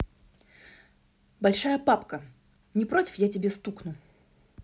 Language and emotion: Russian, neutral